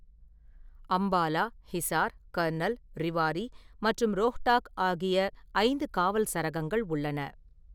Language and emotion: Tamil, neutral